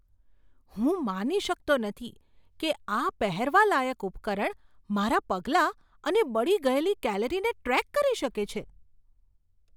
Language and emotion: Gujarati, surprised